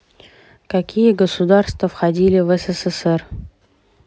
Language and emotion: Russian, neutral